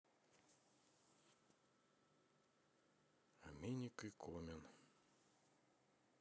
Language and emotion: Russian, neutral